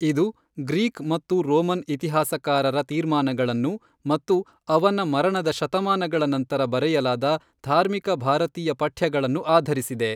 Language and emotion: Kannada, neutral